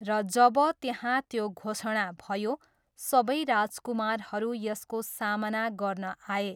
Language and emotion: Nepali, neutral